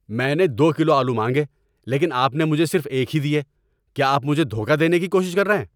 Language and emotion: Urdu, angry